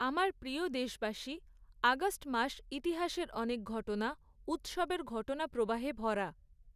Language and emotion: Bengali, neutral